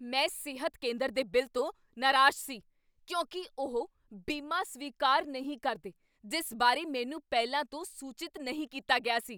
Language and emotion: Punjabi, angry